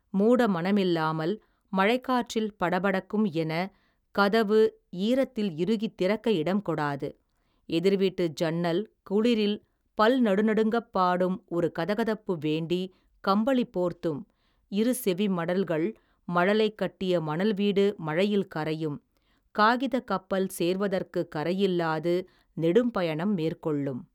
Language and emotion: Tamil, neutral